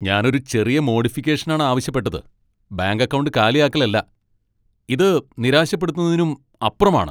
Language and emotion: Malayalam, angry